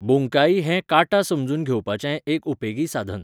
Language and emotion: Goan Konkani, neutral